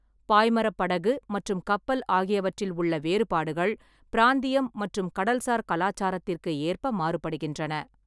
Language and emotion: Tamil, neutral